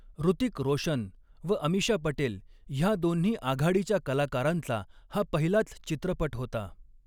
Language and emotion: Marathi, neutral